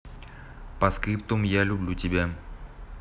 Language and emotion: Russian, neutral